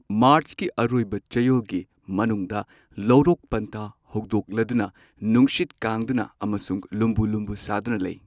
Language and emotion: Manipuri, neutral